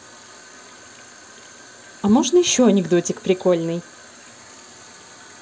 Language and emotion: Russian, positive